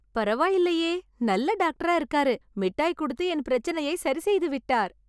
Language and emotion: Tamil, happy